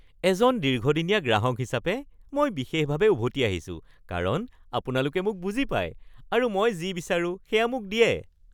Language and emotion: Assamese, happy